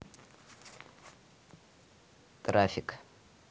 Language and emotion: Russian, neutral